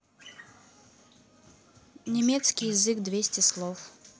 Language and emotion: Russian, neutral